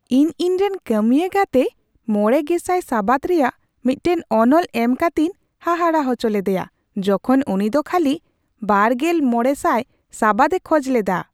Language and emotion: Santali, surprised